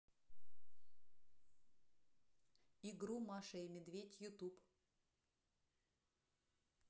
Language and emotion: Russian, neutral